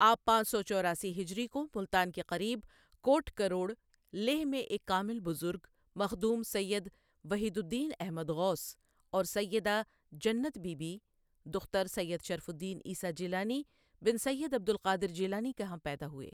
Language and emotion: Urdu, neutral